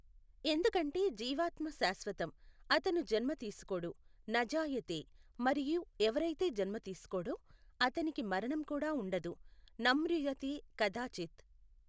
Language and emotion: Telugu, neutral